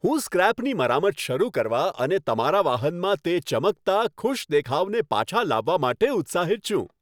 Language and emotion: Gujarati, happy